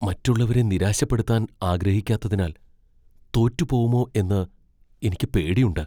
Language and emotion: Malayalam, fearful